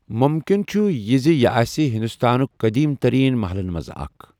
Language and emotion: Kashmiri, neutral